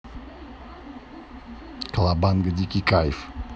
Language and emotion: Russian, neutral